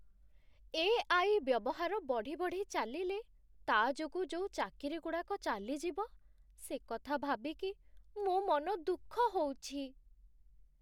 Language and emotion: Odia, sad